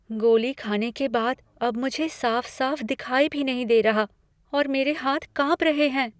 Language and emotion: Hindi, fearful